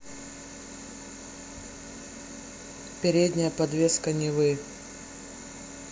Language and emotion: Russian, neutral